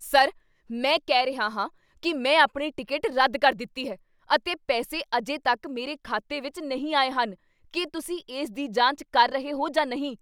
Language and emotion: Punjabi, angry